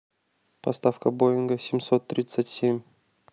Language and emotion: Russian, neutral